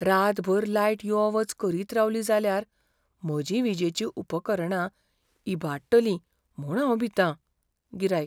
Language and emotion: Goan Konkani, fearful